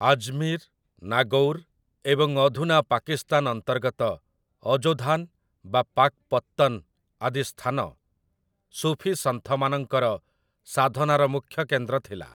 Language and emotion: Odia, neutral